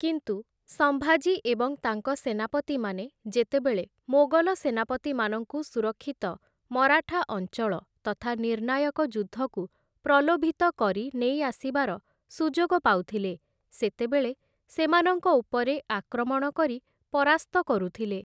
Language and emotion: Odia, neutral